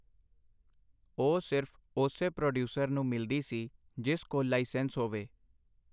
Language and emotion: Punjabi, neutral